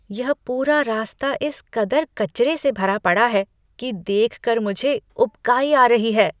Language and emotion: Hindi, disgusted